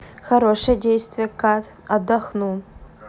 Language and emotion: Russian, positive